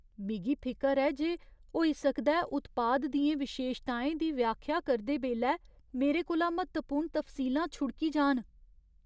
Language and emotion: Dogri, fearful